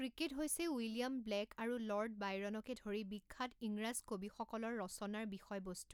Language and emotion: Assamese, neutral